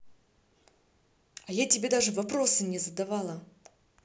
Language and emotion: Russian, angry